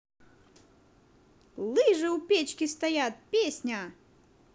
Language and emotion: Russian, positive